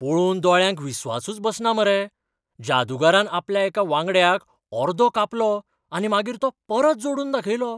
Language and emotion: Goan Konkani, surprised